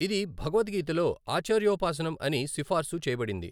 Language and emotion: Telugu, neutral